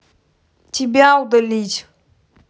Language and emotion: Russian, angry